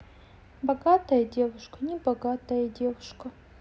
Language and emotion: Russian, sad